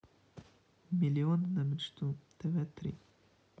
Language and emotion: Russian, neutral